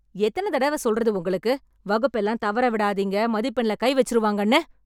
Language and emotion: Tamil, angry